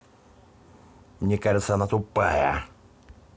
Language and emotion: Russian, angry